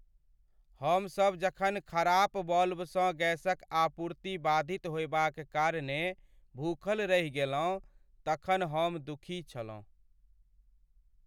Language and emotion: Maithili, sad